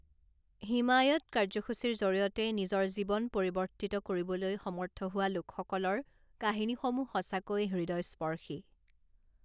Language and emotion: Assamese, neutral